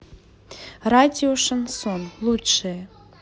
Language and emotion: Russian, neutral